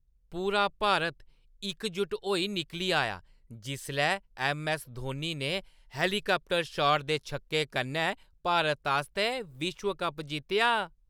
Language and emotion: Dogri, happy